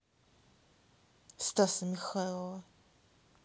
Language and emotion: Russian, neutral